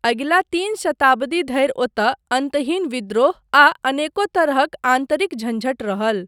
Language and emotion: Maithili, neutral